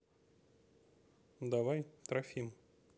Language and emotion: Russian, neutral